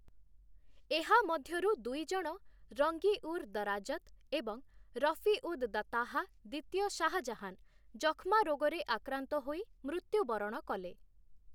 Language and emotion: Odia, neutral